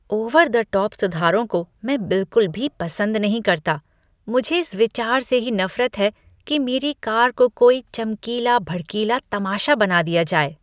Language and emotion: Hindi, disgusted